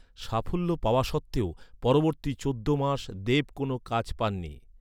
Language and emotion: Bengali, neutral